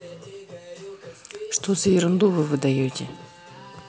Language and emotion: Russian, angry